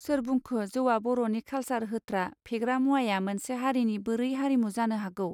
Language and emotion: Bodo, neutral